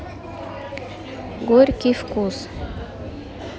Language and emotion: Russian, neutral